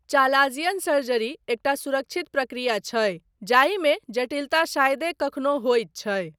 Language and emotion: Maithili, neutral